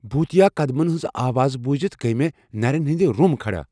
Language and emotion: Kashmiri, fearful